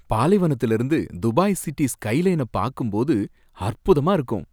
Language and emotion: Tamil, happy